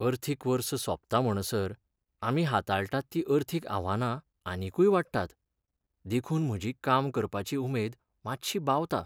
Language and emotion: Goan Konkani, sad